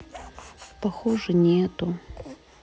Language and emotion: Russian, sad